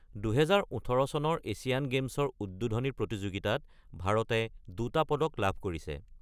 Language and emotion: Assamese, neutral